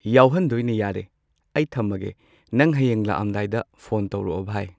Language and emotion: Manipuri, neutral